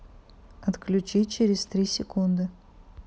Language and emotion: Russian, neutral